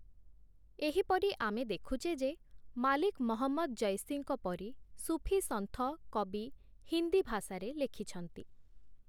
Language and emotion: Odia, neutral